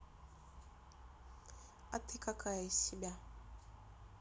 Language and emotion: Russian, neutral